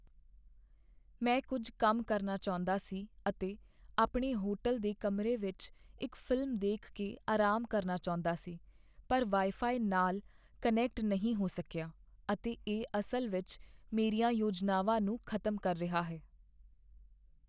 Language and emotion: Punjabi, sad